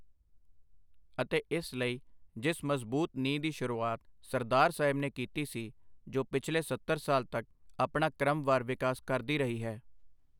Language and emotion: Punjabi, neutral